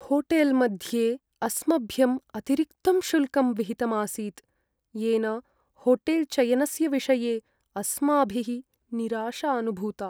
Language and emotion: Sanskrit, sad